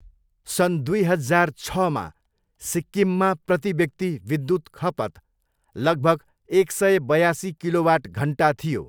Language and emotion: Nepali, neutral